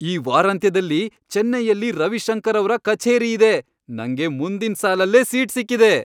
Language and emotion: Kannada, happy